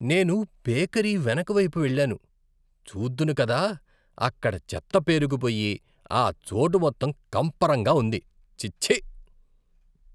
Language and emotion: Telugu, disgusted